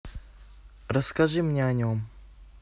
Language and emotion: Russian, neutral